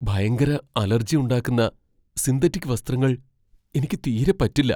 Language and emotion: Malayalam, fearful